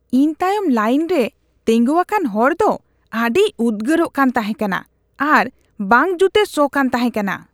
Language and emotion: Santali, disgusted